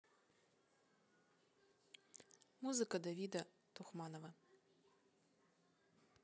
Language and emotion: Russian, neutral